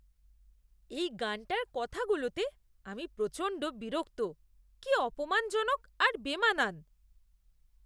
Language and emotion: Bengali, disgusted